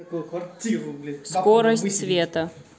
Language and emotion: Russian, neutral